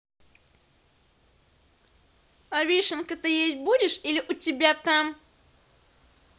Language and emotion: Russian, neutral